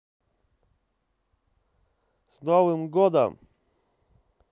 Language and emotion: Russian, positive